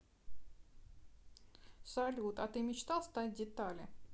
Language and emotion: Russian, neutral